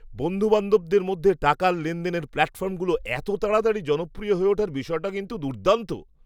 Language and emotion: Bengali, surprised